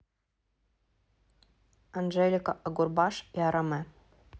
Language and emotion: Russian, neutral